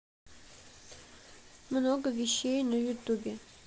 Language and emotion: Russian, neutral